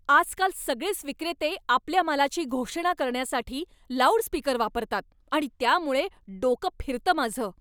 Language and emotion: Marathi, angry